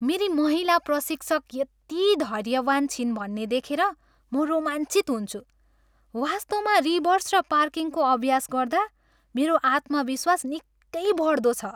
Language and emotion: Nepali, happy